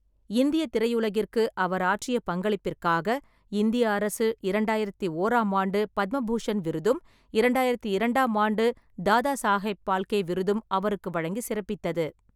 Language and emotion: Tamil, neutral